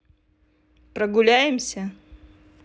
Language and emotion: Russian, neutral